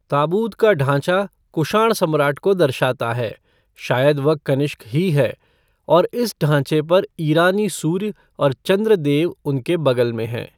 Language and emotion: Hindi, neutral